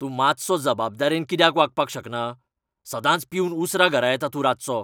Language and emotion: Goan Konkani, angry